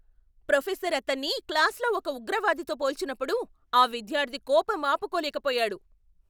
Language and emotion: Telugu, angry